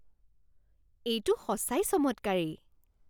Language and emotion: Assamese, surprised